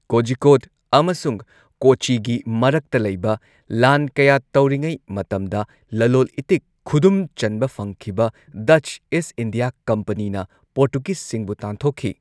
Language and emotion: Manipuri, neutral